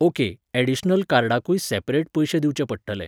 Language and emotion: Goan Konkani, neutral